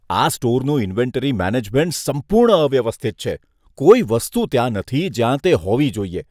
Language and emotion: Gujarati, disgusted